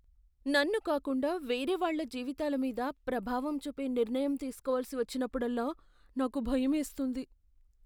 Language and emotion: Telugu, fearful